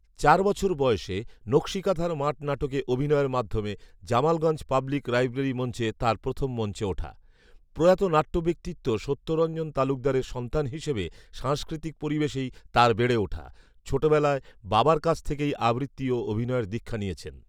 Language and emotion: Bengali, neutral